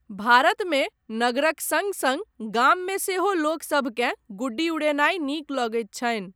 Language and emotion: Maithili, neutral